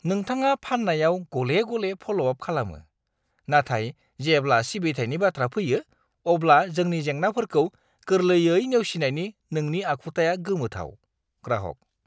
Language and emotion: Bodo, disgusted